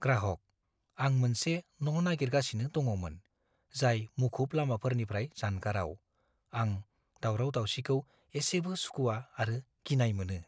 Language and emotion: Bodo, fearful